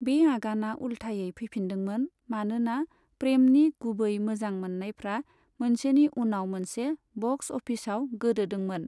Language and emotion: Bodo, neutral